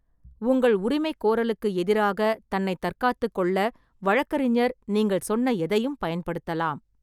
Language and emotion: Tamil, neutral